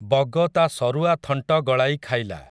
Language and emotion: Odia, neutral